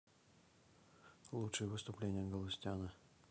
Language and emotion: Russian, neutral